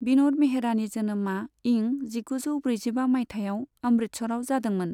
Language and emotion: Bodo, neutral